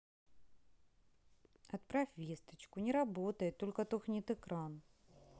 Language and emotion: Russian, sad